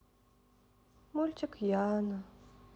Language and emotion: Russian, sad